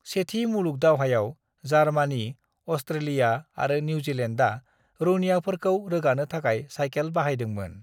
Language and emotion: Bodo, neutral